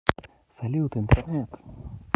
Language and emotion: Russian, positive